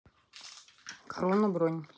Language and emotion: Russian, neutral